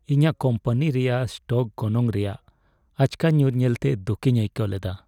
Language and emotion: Santali, sad